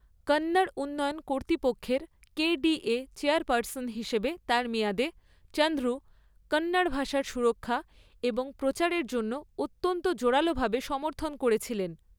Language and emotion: Bengali, neutral